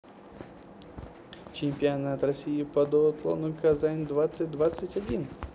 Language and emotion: Russian, positive